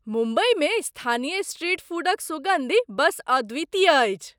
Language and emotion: Maithili, surprised